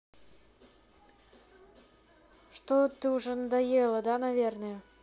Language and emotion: Russian, neutral